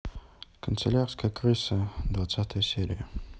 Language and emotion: Russian, neutral